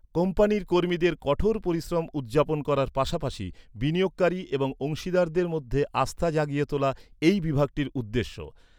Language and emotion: Bengali, neutral